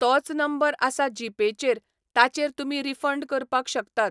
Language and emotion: Goan Konkani, neutral